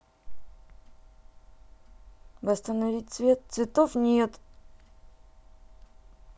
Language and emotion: Russian, sad